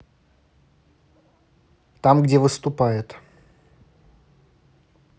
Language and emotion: Russian, neutral